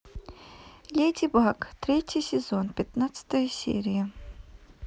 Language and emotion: Russian, neutral